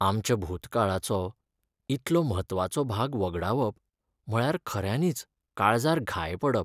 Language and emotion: Goan Konkani, sad